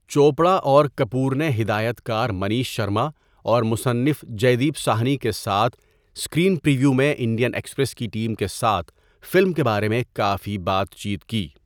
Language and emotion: Urdu, neutral